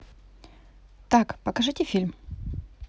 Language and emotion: Russian, neutral